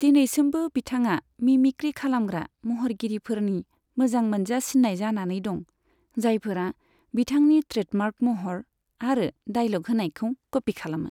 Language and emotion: Bodo, neutral